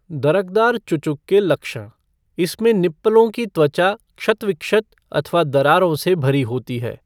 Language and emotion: Hindi, neutral